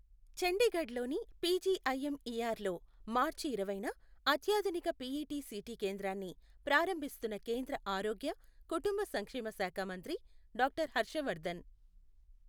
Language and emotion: Telugu, neutral